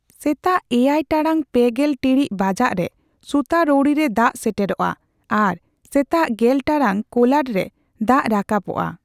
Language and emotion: Santali, neutral